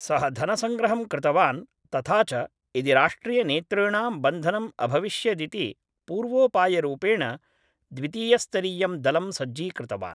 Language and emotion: Sanskrit, neutral